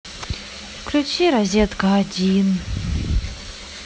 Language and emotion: Russian, sad